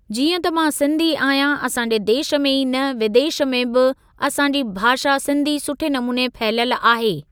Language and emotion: Sindhi, neutral